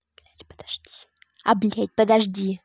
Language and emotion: Russian, angry